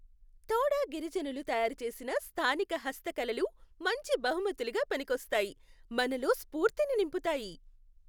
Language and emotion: Telugu, happy